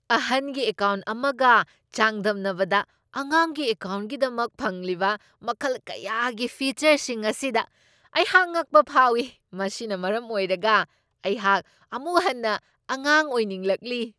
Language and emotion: Manipuri, surprised